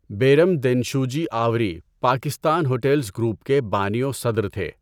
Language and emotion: Urdu, neutral